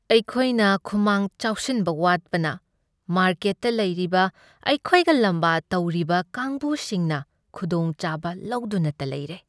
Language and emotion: Manipuri, sad